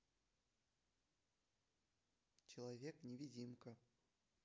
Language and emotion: Russian, neutral